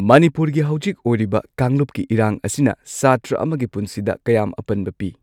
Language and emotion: Manipuri, neutral